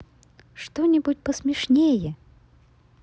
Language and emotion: Russian, positive